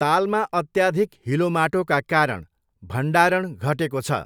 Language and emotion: Nepali, neutral